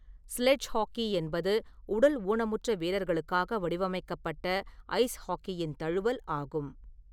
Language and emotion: Tamil, neutral